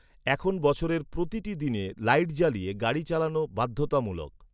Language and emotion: Bengali, neutral